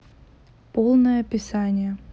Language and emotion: Russian, neutral